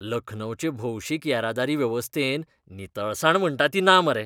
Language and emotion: Goan Konkani, disgusted